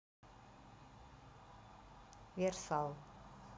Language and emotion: Russian, neutral